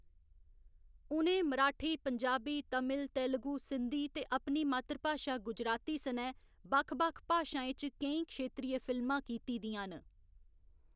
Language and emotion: Dogri, neutral